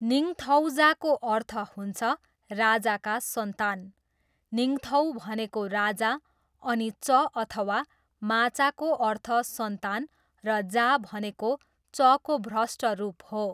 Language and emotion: Nepali, neutral